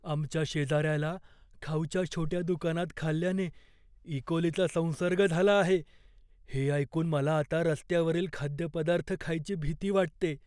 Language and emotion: Marathi, fearful